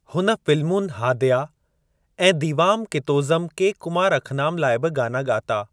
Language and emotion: Sindhi, neutral